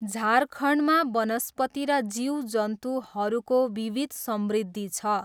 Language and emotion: Nepali, neutral